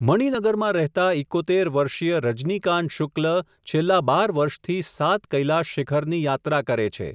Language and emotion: Gujarati, neutral